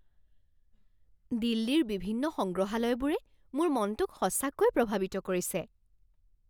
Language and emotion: Assamese, surprised